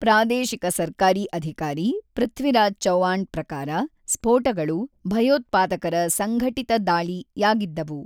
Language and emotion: Kannada, neutral